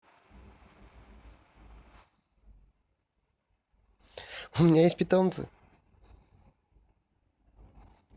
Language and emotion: Russian, positive